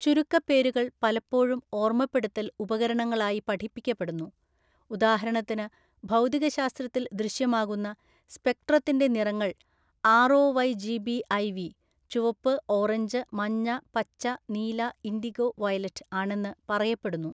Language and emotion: Malayalam, neutral